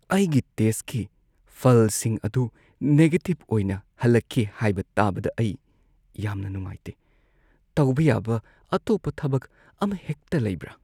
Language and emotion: Manipuri, sad